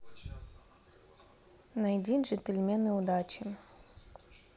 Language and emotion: Russian, neutral